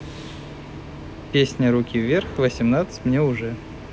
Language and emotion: Russian, neutral